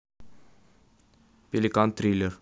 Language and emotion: Russian, neutral